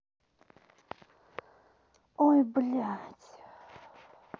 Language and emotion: Russian, angry